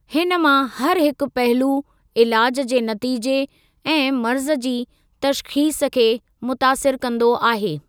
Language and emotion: Sindhi, neutral